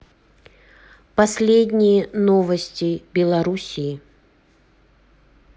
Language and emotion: Russian, neutral